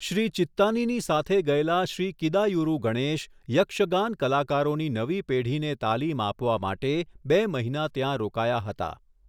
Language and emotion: Gujarati, neutral